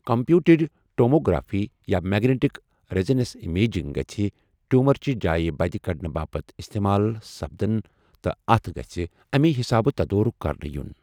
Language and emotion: Kashmiri, neutral